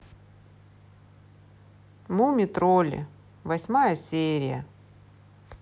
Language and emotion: Russian, neutral